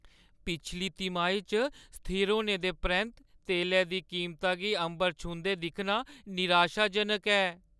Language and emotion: Dogri, sad